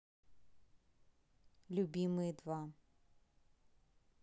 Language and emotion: Russian, neutral